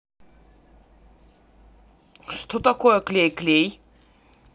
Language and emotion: Russian, neutral